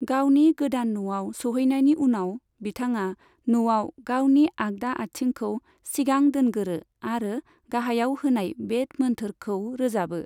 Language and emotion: Bodo, neutral